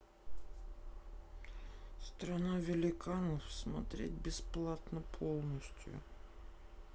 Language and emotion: Russian, sad